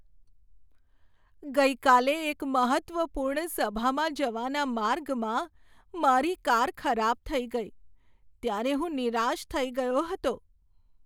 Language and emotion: Gujarati, sad